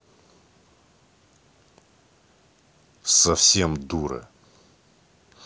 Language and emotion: Russian, angry